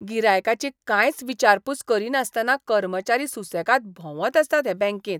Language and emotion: Goan Konkani, disgusted